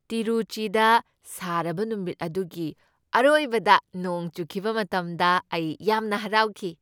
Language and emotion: Manipuri, happy